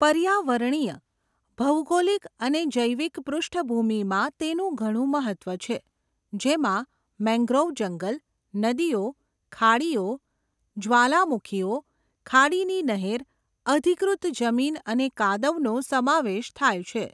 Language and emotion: Gujarati, neutral